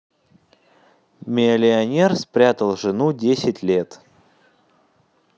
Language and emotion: Russian, neutral